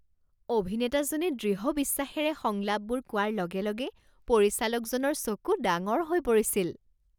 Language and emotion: Assamese, surprised